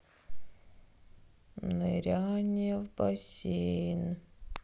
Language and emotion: Russian, sad